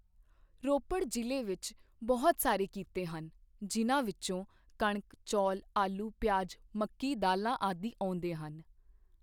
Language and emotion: Punjabi, neutral